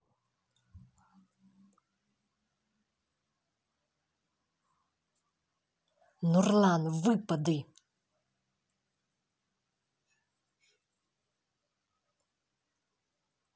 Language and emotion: Russian, angry